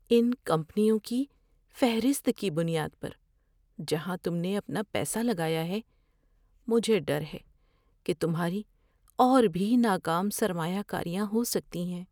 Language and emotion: Urdu, fearful